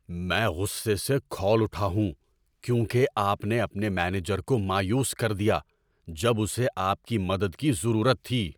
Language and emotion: Urdu, angry